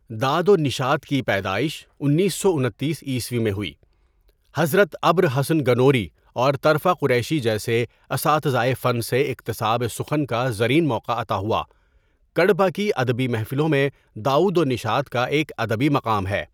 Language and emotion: Urdu, neutral